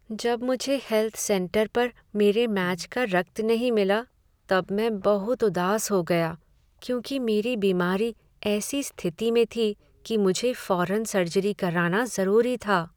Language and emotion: Hindi, sad